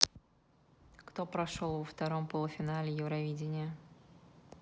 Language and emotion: Russian, neutral